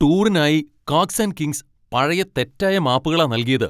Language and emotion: Malayalam, angry